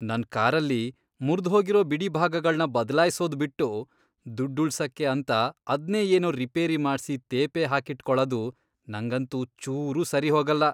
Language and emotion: Kannada, disgusted